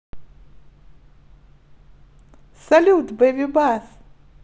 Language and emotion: Russian, positive